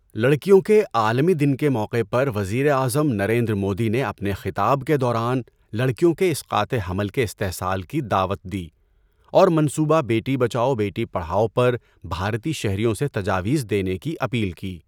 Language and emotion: Urdu, neutral